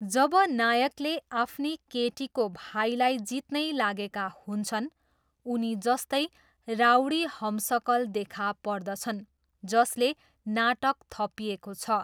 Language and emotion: Nepali, neutral